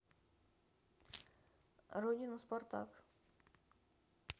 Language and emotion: Russian, neutral